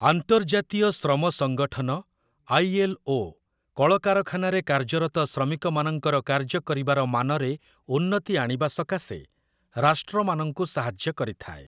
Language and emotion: Odia, neutral